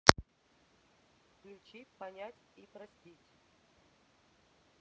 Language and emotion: Russian, neutral